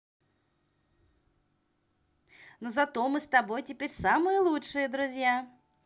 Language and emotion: Russian, positive